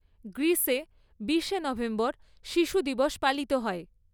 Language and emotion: Bengali, neutral